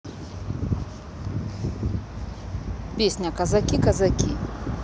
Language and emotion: Russian, neutral